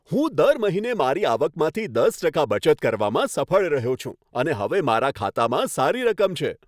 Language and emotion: Gujarati, happy